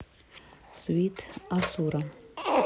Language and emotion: Russian, neutral